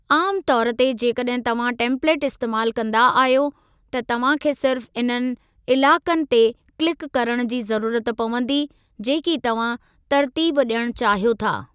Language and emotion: Sindhi, neutral